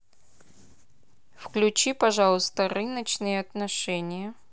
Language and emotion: Russian, neutral